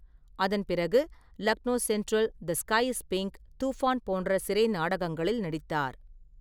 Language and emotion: Tamil, neutral